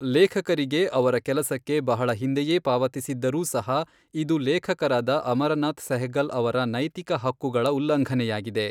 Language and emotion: Kannada, neutral